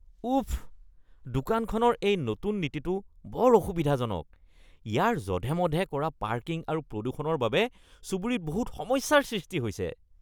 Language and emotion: Assamese, disgusted